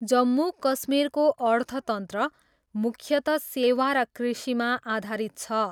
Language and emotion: Nepali, neutral